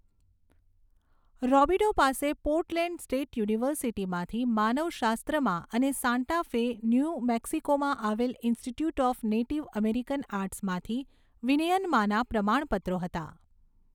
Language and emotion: Gujarati, neutral